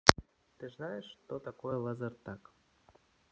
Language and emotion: Russian, neutral